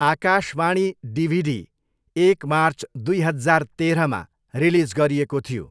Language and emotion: Nepali, neutral